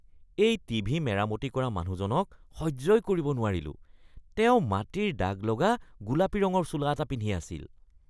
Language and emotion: Assamese, disgusted